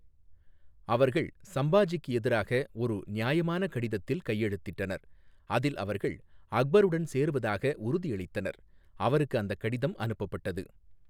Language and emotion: Tamil, neutral